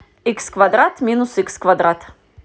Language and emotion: Russian, neutral